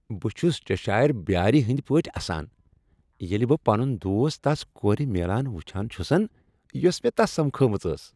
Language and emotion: Kashmiri, happy